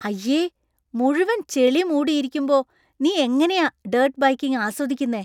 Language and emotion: Malayalam, disgusted